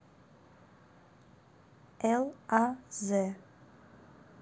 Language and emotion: Russian, neutral